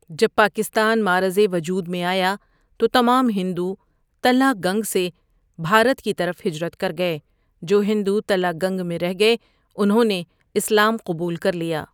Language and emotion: Urdu, neutral